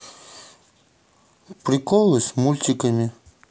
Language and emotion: Russian, neutral